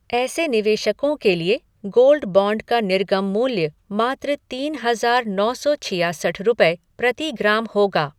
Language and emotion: Hindi, neutral